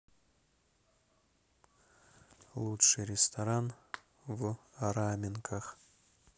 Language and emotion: Russian, neutral